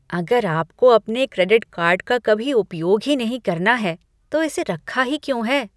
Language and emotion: Hindi, disgusted